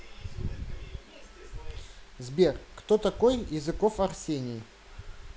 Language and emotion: Russian, neutral